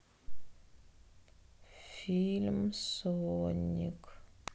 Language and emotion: Russian, sad